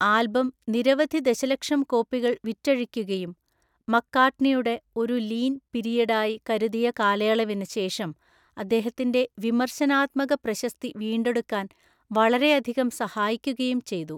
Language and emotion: Malayalam, neutral